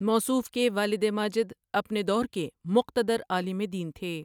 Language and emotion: Urdu, neutral